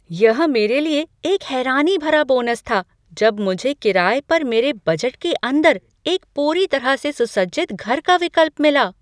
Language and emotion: Hindi, surprised